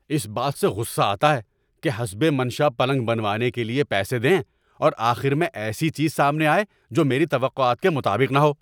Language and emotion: Urdu, angry